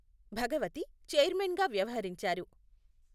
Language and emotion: Telugu, neutral